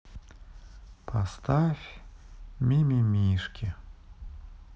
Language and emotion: Russian, sad